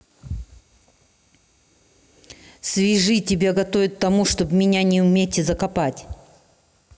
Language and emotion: Russian, angry